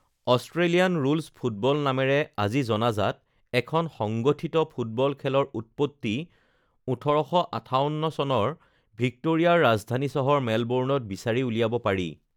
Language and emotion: Assamese, neutral